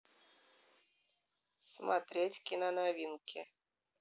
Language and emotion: Russian, neutral